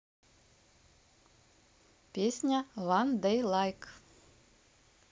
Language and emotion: Russian, neutral